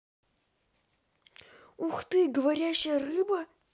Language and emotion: Russian, positive